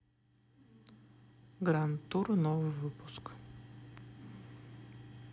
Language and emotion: Russian, neutral